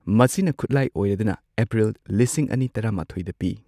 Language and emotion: Manipuri, neutral